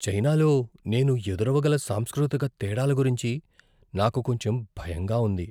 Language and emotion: Telugu, fearful